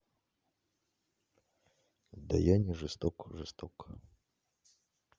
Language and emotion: Russian, neutral